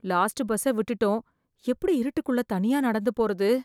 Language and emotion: Tamil, fearful